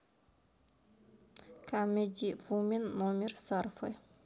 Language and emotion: Russian, neutral